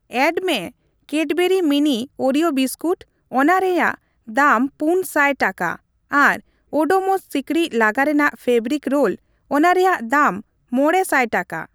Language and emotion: Santali, neutral